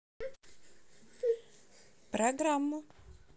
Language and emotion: Russian, positive